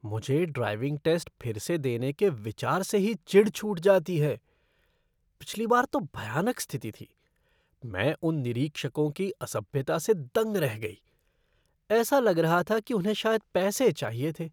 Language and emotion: Hindi, disgusted